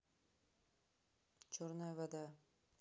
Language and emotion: Russian, neutral